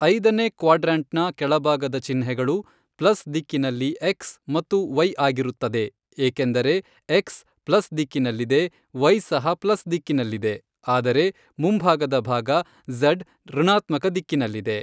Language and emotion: Kannada, neutral